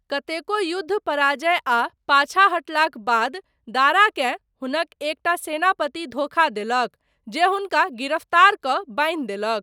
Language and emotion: Maithili, neutral